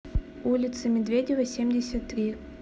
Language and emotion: Russian, neutral